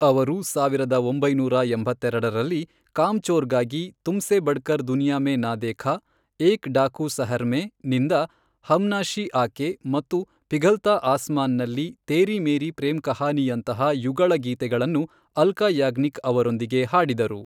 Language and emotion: Kannada, neutral